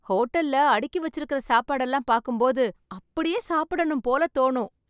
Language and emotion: Tamil, happy